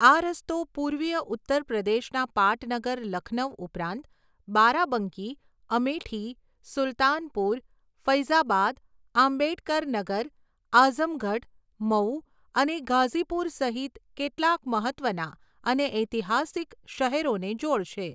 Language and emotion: Gujarati, neutral